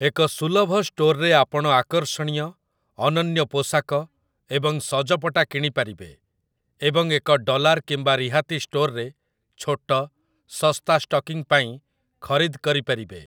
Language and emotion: Odia, neutral